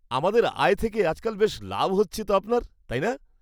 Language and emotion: Bengali, happy